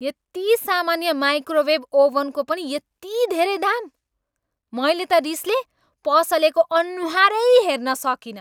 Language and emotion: Nepali, angry